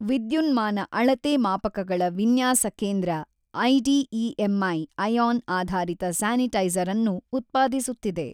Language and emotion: Kannada, neutral